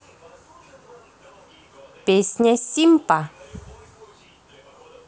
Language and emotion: Russian, positive